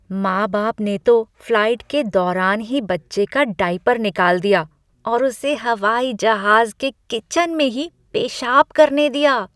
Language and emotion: Hindi, disgusted